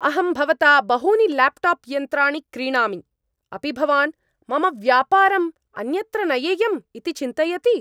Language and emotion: Sanskrit, angry